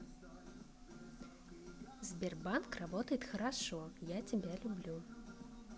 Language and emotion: Russian, positive